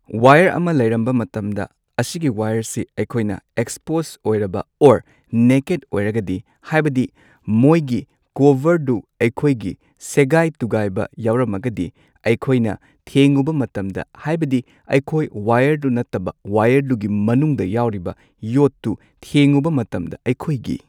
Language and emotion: Manipuri, neutral